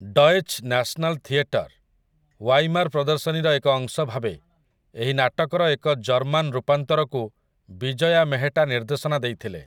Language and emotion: Odia, neutral